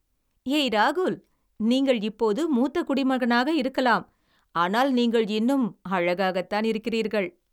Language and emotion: Tamil, happy